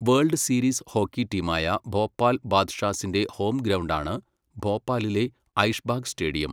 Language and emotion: Malayalam, neutral